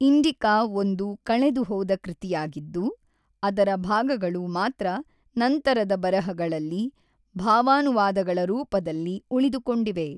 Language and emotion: Kannada, neutral